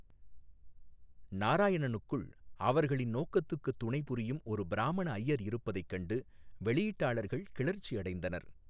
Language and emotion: Tamil, neutral